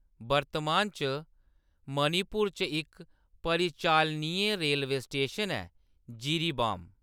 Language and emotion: Dogri, neutral